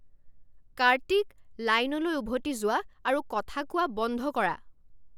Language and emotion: Assamese, angry